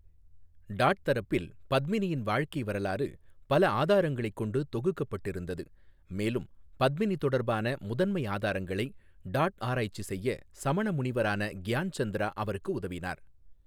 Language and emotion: Tamil, neutral